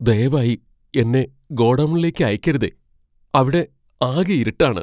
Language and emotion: Malayalam, fearful